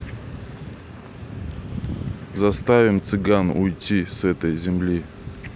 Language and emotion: Russian, neutral